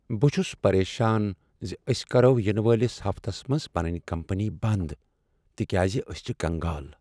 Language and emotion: Kashmiri, sad